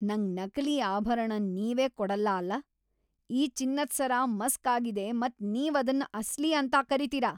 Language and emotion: Kannada, angry